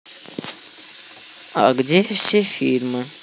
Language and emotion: Russian, neutral